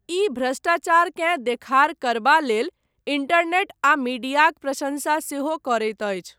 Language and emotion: Maithili, neutral